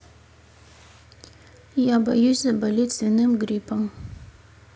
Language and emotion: Russian, neutral